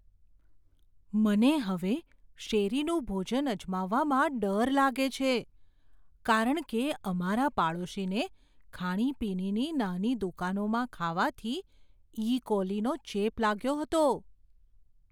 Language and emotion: Gujarati, fearful